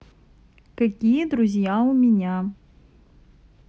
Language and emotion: Russian, neutral